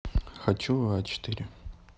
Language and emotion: Russian, neutral